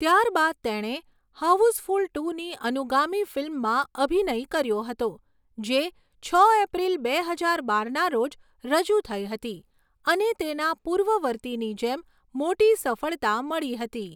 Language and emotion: Gujarati, neutral